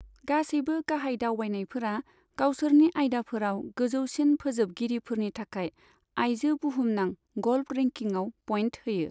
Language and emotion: Bodo, neutral